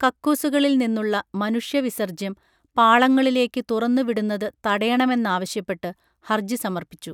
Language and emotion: Malayalam, neutral